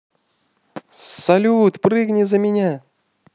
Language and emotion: Russian, positive